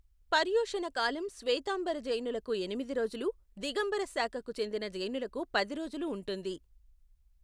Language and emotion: Telugu, neutral